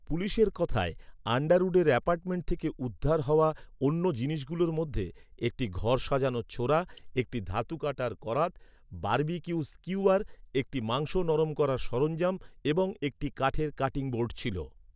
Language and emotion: Bengali, neutral